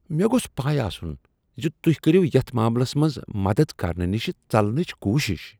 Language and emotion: Kashmiri, disgusted